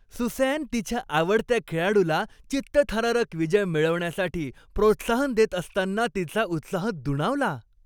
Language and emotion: Marathi, happy